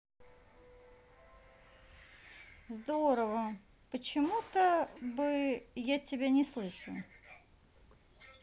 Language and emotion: Russian, neutral